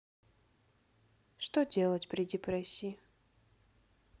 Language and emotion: Russian, neutral